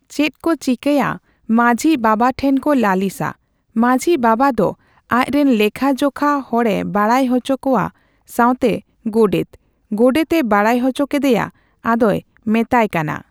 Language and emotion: Santali, neutral